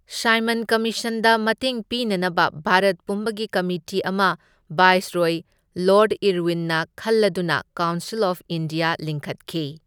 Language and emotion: Manipuri, neutral